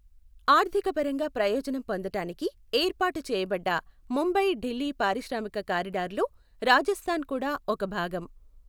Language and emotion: Telugu, neutral